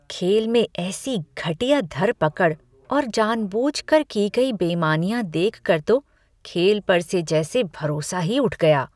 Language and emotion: Hindi, disgusted